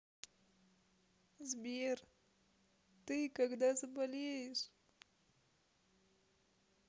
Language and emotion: Russian, sad